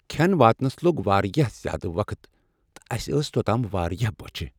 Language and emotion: Kashmiri, sad